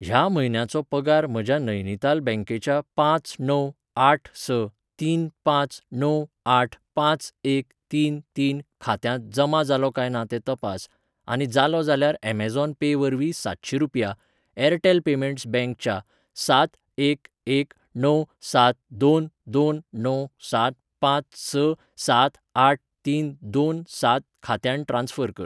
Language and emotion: Goan Konkani, neutral